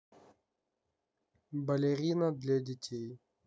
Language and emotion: Russian, neutral